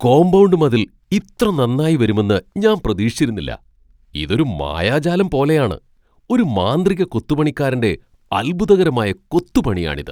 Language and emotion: Malayalam, surprised